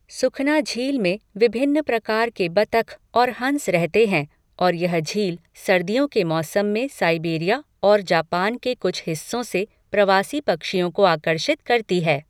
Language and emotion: Hindi, neutral